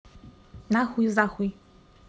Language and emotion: Russian, angry